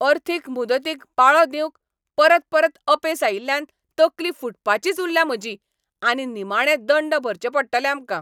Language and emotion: Goan Konkani, angry